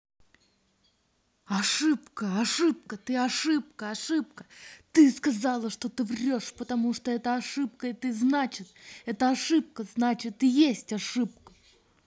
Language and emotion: Russian, angry